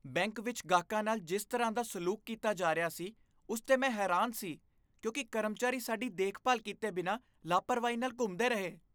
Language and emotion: Punjabi, disgusted